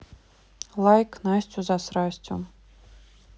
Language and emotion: Russian, neutral